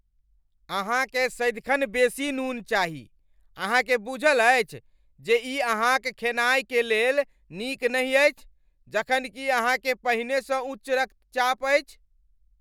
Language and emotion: Maithili, angry